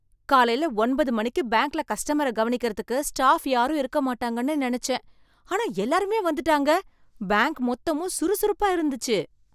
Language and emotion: Tamil, surprised